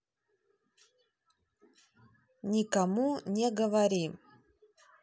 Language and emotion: Russian, neutral